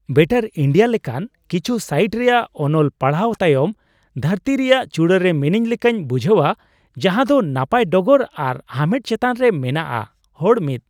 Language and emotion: Santali, happy